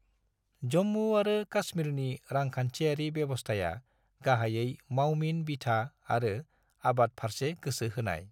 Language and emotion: Bodo, neutral